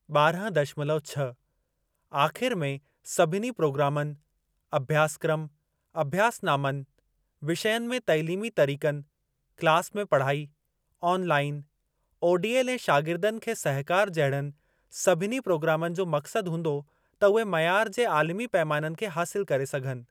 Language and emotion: Sindhi, neutral